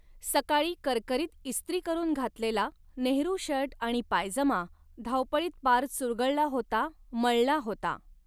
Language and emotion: Marathi, neutral